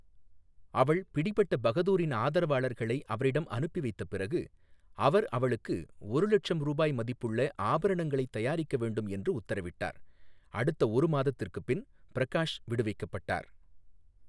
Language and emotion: Tamil, neutral